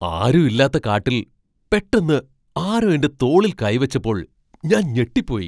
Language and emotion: Malayalam, surprised